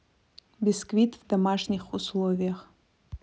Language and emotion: Russian, neutral